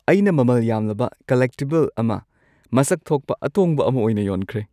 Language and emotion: Manipuri, happy